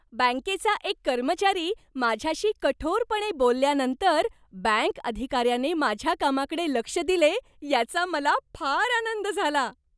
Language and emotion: Marathi, happy